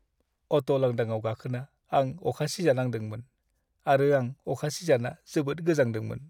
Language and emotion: Bodo, sad